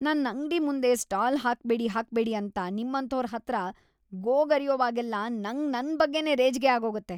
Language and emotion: Kannada, disgusted